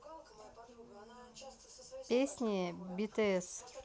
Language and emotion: Russian, neutral